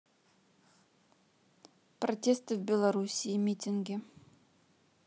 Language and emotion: Russian, neutral